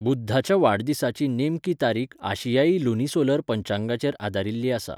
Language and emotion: Goan Konkani, neutral